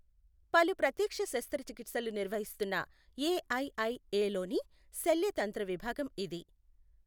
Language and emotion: Telugu, neutral